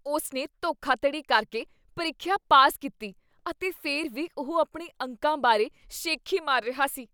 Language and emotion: Punjabi, disgusted